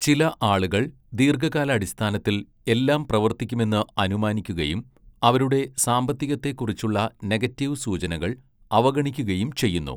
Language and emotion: Malayalam, neutral